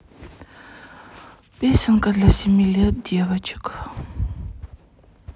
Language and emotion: Russian, sad